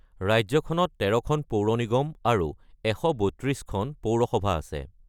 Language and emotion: Assamese, neutral